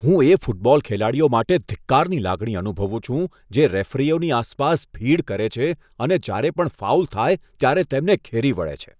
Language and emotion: Gujarati, disgusted